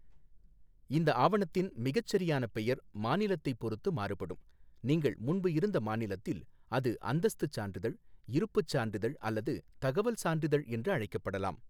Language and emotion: Tamil, neutral